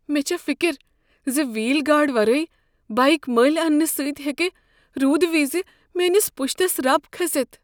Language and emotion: Kashmiri, fearful